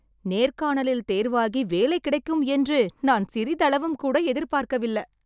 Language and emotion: Tamil, happy